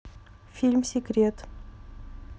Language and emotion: Russian, neutral